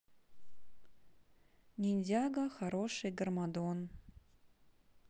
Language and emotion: Russian, neutral